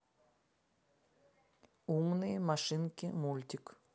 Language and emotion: Russian, neutral